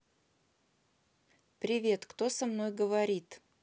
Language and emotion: Russian, neutral